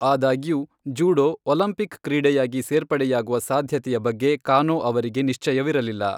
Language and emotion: Kannada, neutral